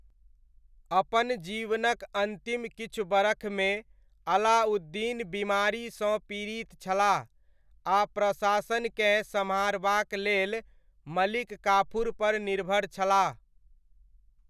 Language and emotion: Maithili, neutral